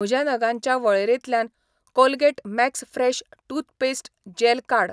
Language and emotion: Goan Konkani, neutral